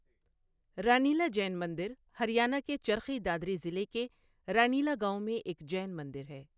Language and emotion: Urdu, neutral